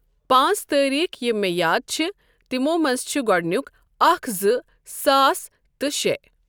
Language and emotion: Kashmiri, neutral